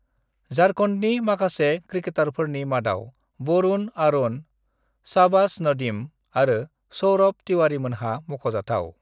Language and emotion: Bodo, neutral